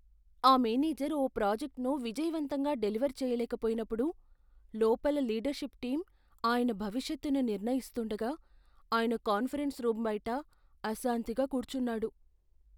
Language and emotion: Telugu, fearful